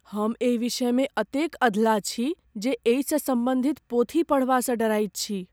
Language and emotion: Maithili, fearful